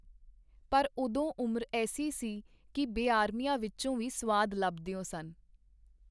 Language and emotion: Punjabi, neutral